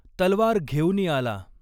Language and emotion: Marathi, neutral